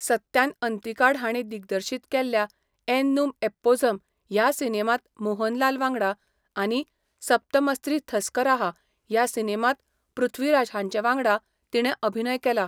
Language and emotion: Goan Konkani, neutral